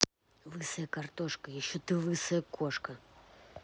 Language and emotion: Russian, angry